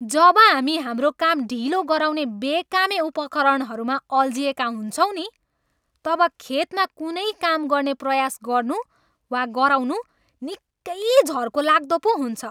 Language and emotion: Nepali, angry